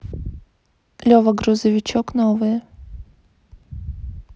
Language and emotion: Russian, neutral